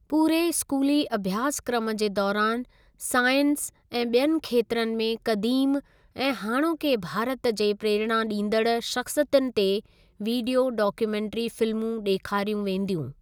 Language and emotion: Sindhi, neutral